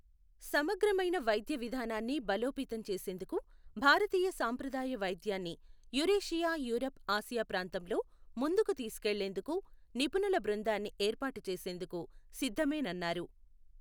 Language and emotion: Telugu, neutral